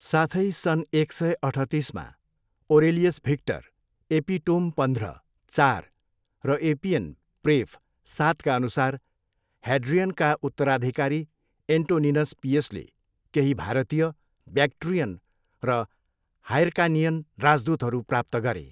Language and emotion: Nepali, neutral